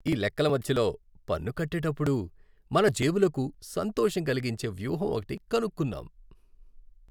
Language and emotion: Telugu, happy